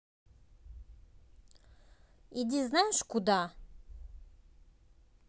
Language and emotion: Russian, angry